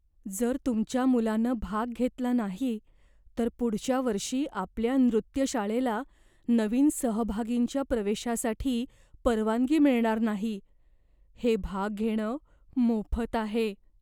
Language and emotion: Marathi, fearful